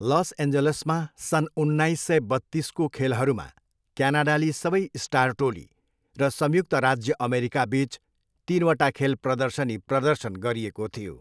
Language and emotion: Nepali, neutral